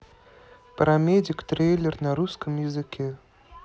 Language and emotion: Russian, neutral